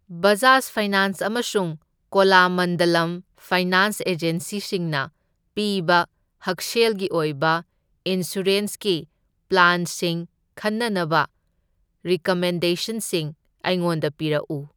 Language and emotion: Manipuri, neutral